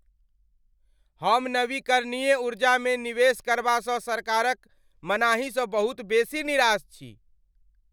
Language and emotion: Maithili, angry